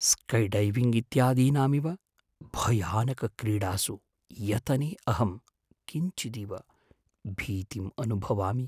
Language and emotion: Sanskrit, fearful